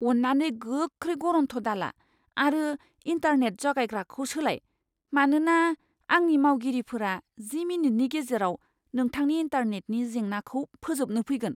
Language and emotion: Bodo, fearful